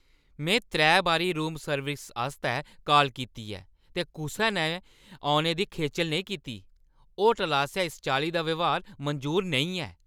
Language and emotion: Dogri, angry